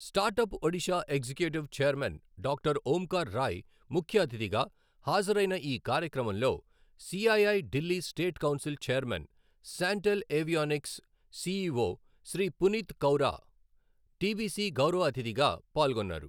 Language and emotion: Telugu, neutral